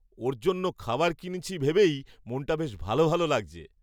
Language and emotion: Bengali, happy